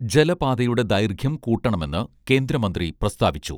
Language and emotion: Malayalam, neutral